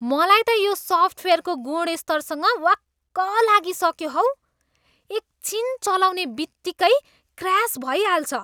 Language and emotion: Nepali, disgusted